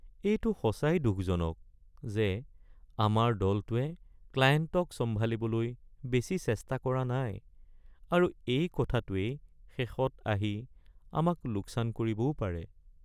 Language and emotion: Assamese, sad